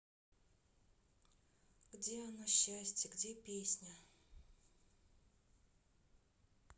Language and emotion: Russian, sad